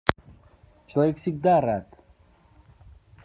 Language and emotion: Russian, neutral